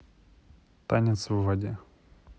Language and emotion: Russian, neutral